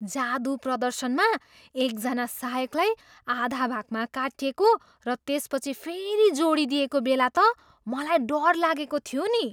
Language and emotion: Nepali, surprised